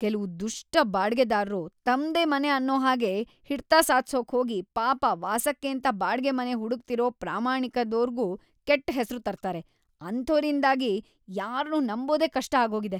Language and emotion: Kannada, disgusted